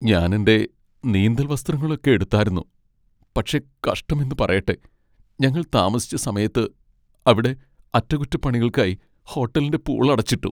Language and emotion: Malayalam, sad